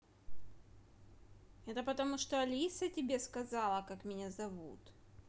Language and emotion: Russian, neutral